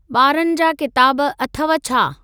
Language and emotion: Sindhi, neutral